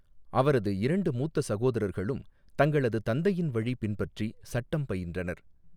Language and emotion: Tamil, neutral